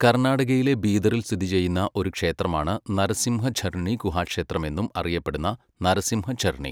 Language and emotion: Malayalam, neutral